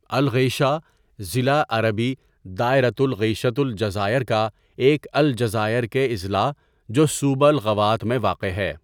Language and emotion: Urdu, neutral